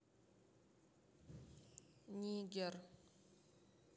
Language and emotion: Russian, neutral